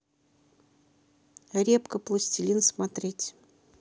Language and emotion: Russian, neutral